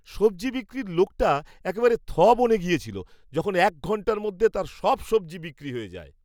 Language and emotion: Bengali, surprised